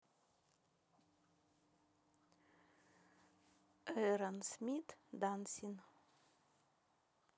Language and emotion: Russian, neutral